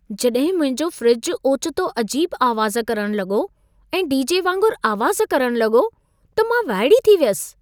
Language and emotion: Sindhi, surprised